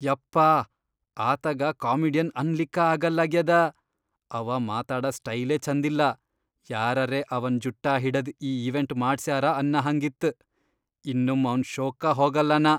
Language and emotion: Kannada, disgusted